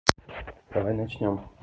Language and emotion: Russian, neutral